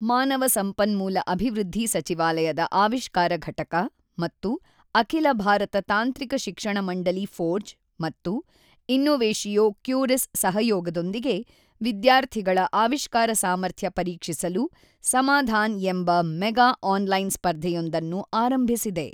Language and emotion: Kannada, neutral